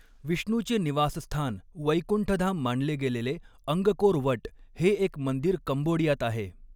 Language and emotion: Marathi, neutral